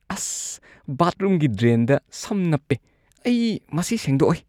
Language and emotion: Manipuri, disgusted